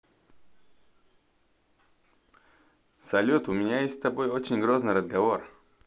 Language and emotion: Russian, positive